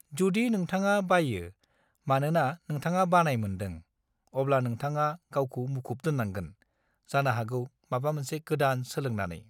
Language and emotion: Bodo, neutral